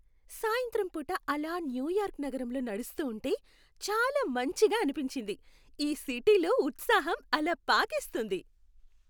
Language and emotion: Telugu, happy